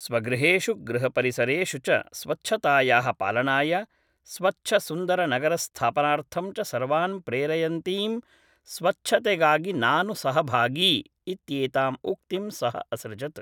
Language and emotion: Sanskrit, neutral